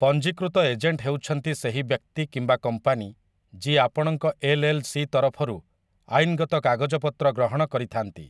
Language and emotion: Odia, neutral